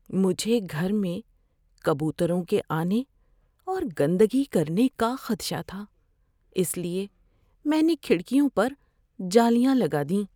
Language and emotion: Urdu, fearful